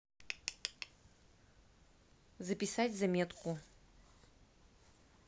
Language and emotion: Russian, neutral